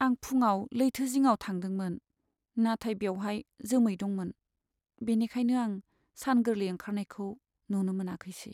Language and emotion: Bodo, sad